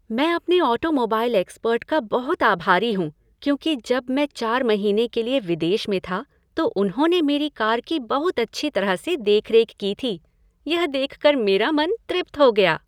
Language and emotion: Hindi, happy